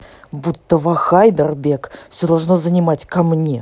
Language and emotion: Russian, angry